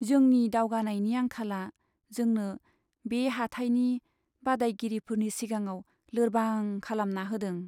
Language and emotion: Bodo, sad